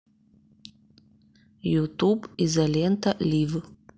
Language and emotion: Russian, neutral